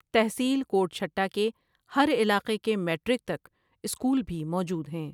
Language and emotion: Urdu, neutral